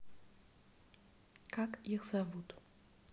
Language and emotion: Russian, neutral